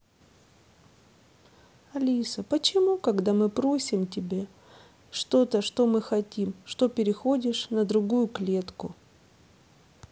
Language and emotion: Russian, sad